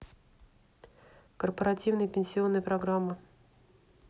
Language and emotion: Russian, neutral